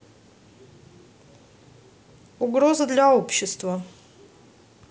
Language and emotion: Russian, neutral